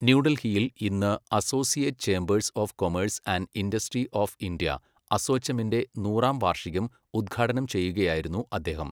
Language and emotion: Malayalam, neutral